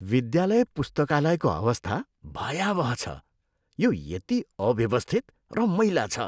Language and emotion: Nepali, disgusted